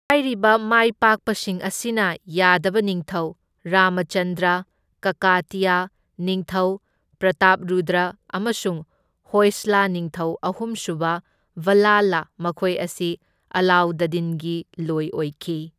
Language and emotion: Manipuri, neutral